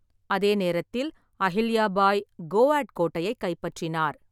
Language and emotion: Tamil, neutral